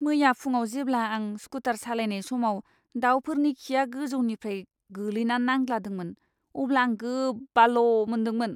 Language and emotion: Bodo, disgusted